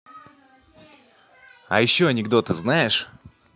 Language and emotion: Russian, positive